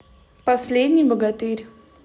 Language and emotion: Russian, neutral